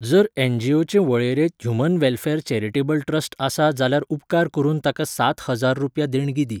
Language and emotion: Goan Konkani, neutral